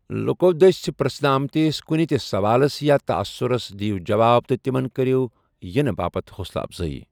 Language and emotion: Kashmiri, neutral